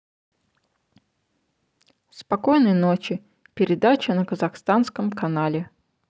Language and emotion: Russian, neutral